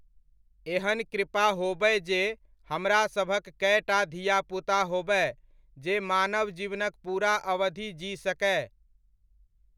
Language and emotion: Maithili, neutral